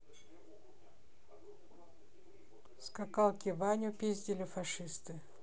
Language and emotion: Russian, neutral